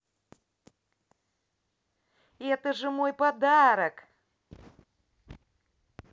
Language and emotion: Russian, positive